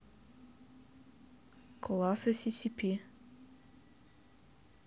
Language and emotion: Russian, neutral